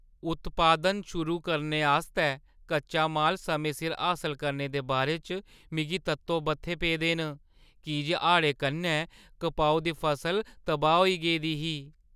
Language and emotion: Dogri, fearful